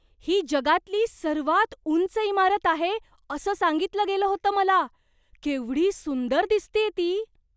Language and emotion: Marathi, surprised